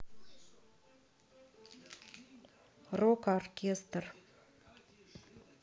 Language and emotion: Russian, neutral